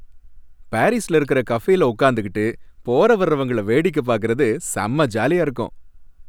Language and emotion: Tamil, happy